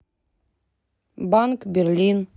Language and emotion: Russian, neutral